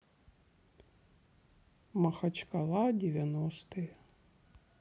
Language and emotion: Russian, sad